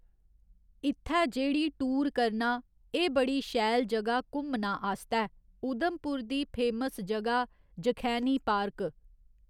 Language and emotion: Dogri, neutral